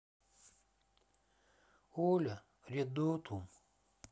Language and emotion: Russian, sad